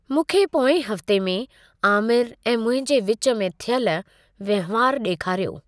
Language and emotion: Sindhi, neutral